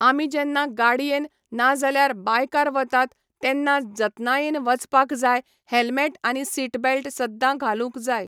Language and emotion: Goan Konkani, neutral